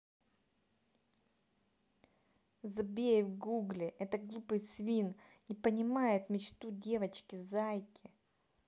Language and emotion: Russian, angry